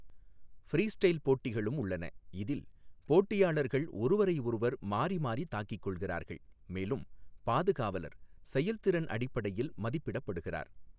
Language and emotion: Tamil, neutral